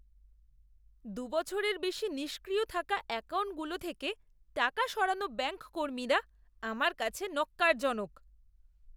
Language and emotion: Bengali, disgusted